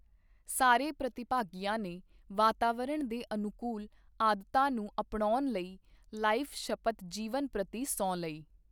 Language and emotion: Punjabi, neutral